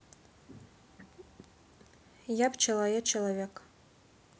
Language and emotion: Russian, neutral